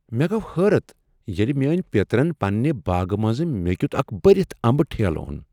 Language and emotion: Kashmiri, surprised